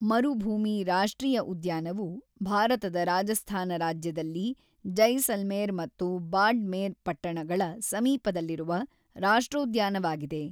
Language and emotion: Kannada, neutral